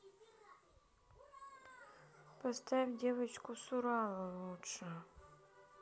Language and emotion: Russian, sad